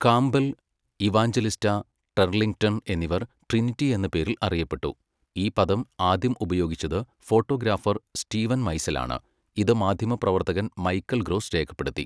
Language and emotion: Malayalam, neutral